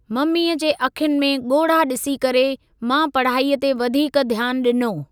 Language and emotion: Sindhi, neutral